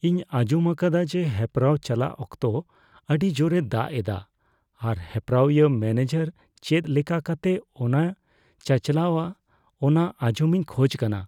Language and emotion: Santali, fearful